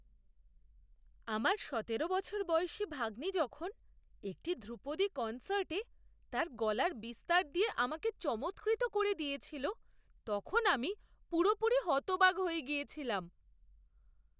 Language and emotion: Bengali, surprised